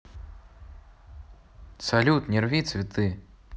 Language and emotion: Russian, neutral